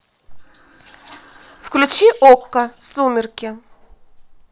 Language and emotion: Russian, neutral